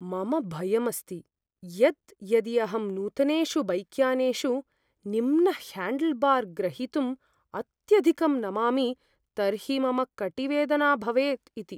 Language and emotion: Sanskrit, fearful